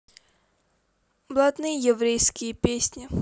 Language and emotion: Russian, neutral